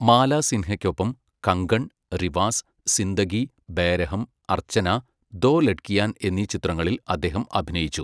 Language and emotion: Malayalam, neutral